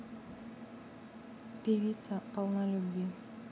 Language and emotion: Russian, neutral